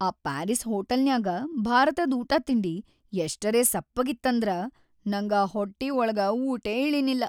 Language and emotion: Kannada, sad